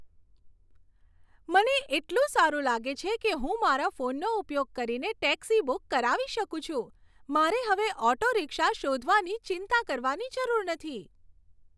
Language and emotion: Gujarati, happy